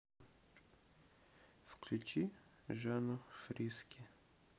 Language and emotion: Russian, neutral